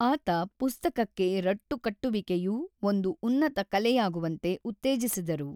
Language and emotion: Kannada, neutral